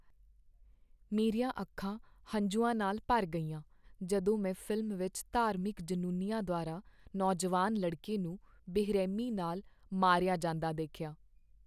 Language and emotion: Punjabi, sad